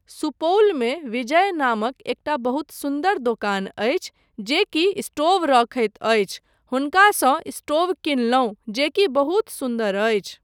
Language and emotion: Maithili, neutral